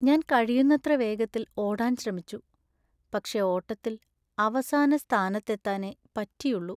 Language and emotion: Malayalam, sad